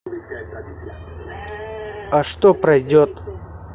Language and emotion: Russian, neutral